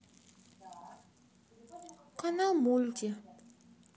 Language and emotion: Russian, sad